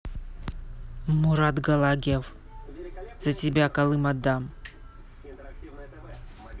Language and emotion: Russian, neutral